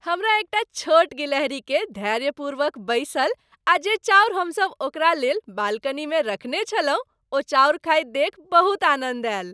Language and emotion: Maithili, happy